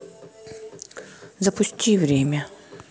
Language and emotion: Russian, neutral